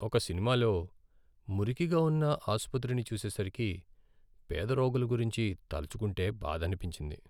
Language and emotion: Telugu, sad